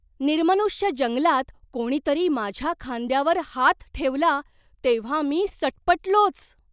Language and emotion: Marathi, surprised